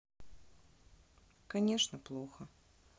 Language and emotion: Russian, sad